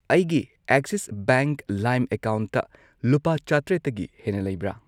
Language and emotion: Manipuri, neutral